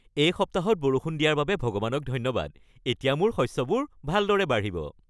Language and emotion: Assamese, happy